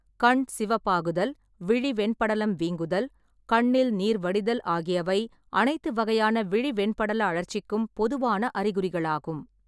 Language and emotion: Tamil, neutral